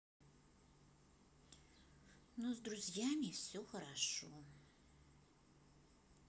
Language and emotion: Russian, neutral